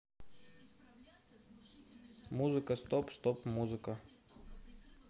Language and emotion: Russian, neutral